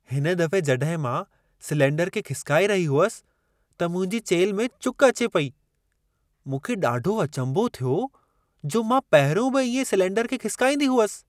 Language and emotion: Sindhi, surprised